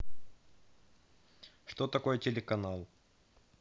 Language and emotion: Russian, neutral